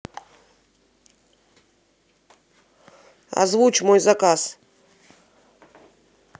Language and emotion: Russian, neutral